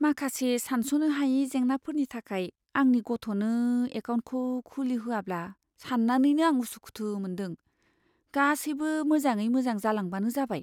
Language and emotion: Bodo, fearful